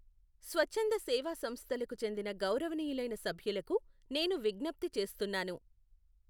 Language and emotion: Telugu, neutral